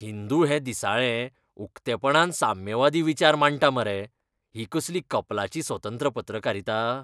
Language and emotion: Goan Konkani, disgusted